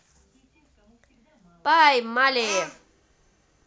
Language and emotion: Russian, positive